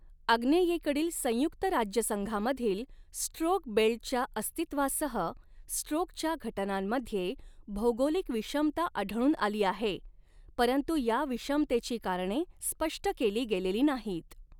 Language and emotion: Marathi, neutral